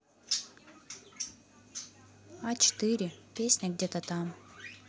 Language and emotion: Russian, neutral